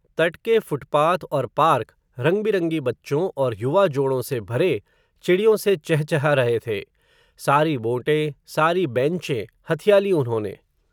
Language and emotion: Hindi, neutral